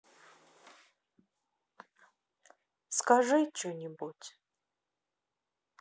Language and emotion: Russian, sad